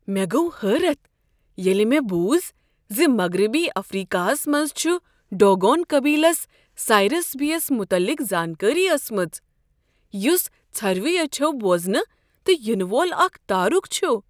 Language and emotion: Kashmiri, surprised